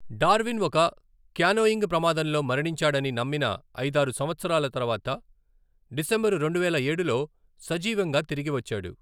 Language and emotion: Telugu, neutral